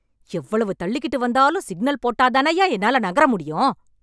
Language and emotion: Tamil, angry